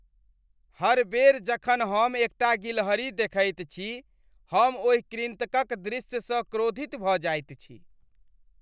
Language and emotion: Maithili, disgusted